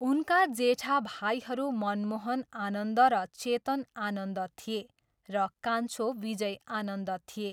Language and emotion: Nepali, neutral